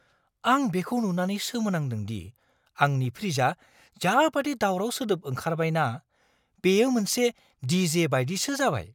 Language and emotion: Bodo, surprised